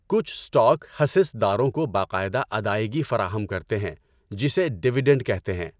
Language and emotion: Urdu, neutral